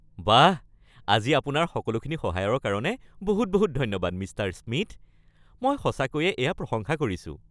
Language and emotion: Assamese, happy